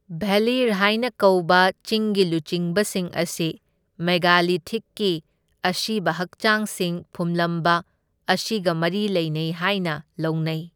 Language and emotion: Manipuri, neutral